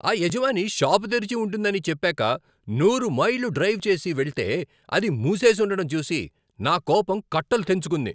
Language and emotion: Telugu, angry